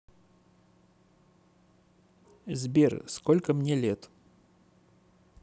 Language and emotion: Russian, neutral